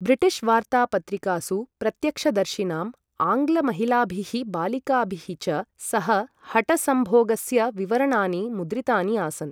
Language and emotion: Sanskrit, neutral